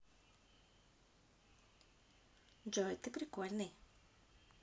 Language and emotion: Russian, positive